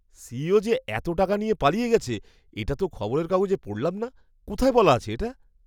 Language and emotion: Bengali, surprised